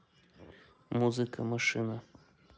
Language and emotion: Russian, neutral